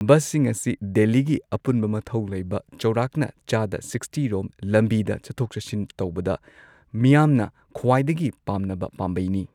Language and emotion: Manipuri, neutral